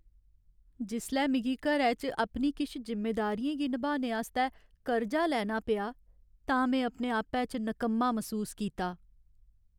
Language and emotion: Dogri, sad